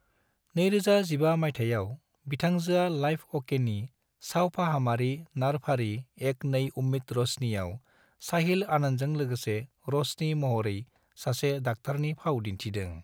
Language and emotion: Bodo, neutral